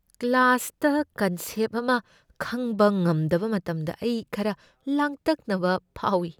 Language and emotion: Manipuri, fearful